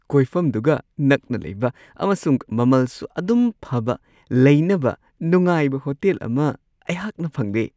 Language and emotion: Manipuri, happy